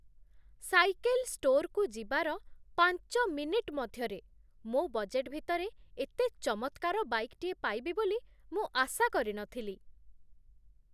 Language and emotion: Odia, surprised